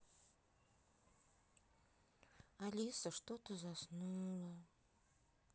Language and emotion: Russian, neutral